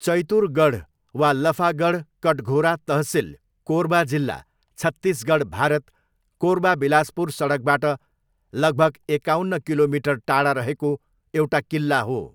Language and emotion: Nepali, neutral